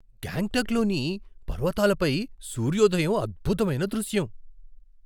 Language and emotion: Telugu, surprised